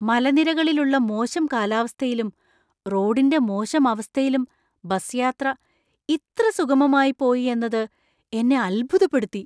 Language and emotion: Malayalam, surprised